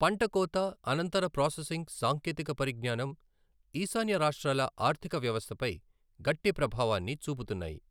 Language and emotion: Telugu, neutral